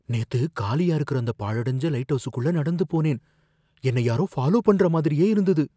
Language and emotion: Tamil, fearful